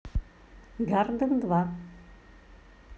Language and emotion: Russian, neutral